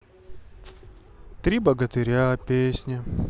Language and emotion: Russian, sad